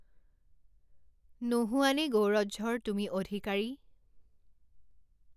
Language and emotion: Assamese, neutral